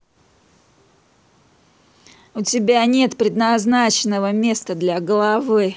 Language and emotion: Russian, angry